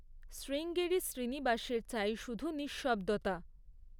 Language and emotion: Bengali, neutral